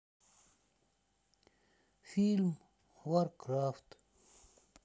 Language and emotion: Russian, sad